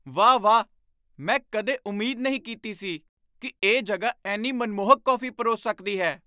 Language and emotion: Punjabi, surprised